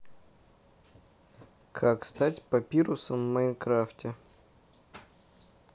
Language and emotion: Russian, neutral